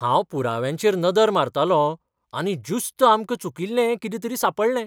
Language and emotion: Goan Konkani, surprised